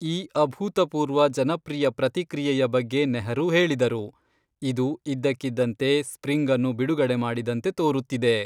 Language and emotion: Kannada, neutral